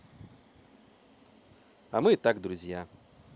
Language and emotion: Russian, positive